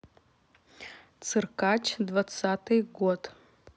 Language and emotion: Russian, neutral